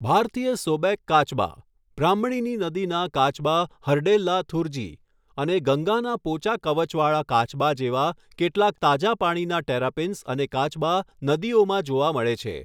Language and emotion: Gujarati, neutral